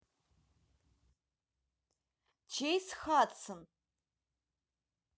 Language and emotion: Russian, neutral